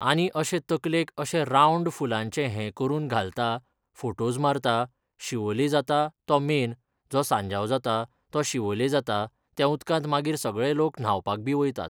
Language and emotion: Goan Konkani, neutral